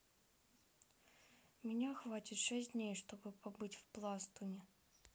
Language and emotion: Russian, sad